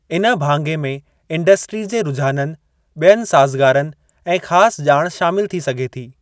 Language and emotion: Sindhi, neutral